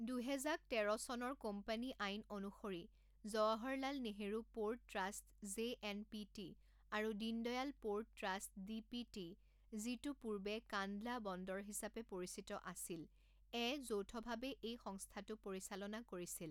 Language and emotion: Assamese, neutral